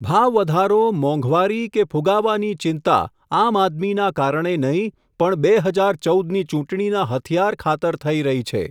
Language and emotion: Gujarati, neutral